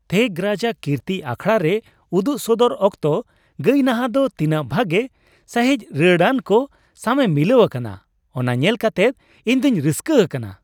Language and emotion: Santali, happy